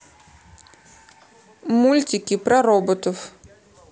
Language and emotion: Russian, neutral